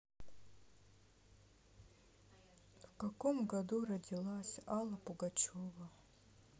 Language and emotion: Russian, sad